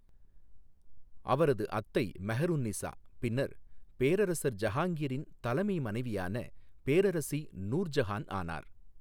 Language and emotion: Tamil, neutral